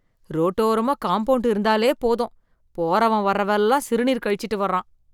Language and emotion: Tamil, disgusted